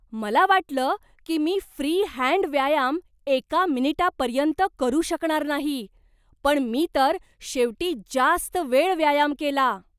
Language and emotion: Marathi, surprised